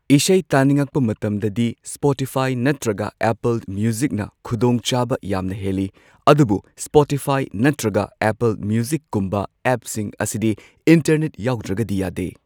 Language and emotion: Manipuri, neutral